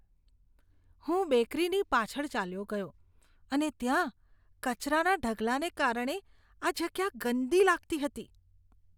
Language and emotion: Gujarati, disgusted